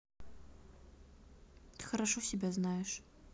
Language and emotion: Russian, neutral